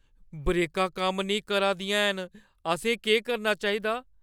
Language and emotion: Dogri, fearful